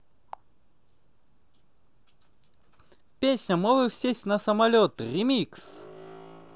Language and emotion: Russian, positive